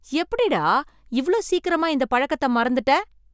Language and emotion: Tamil, surprised